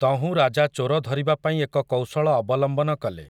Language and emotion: Odia, neutral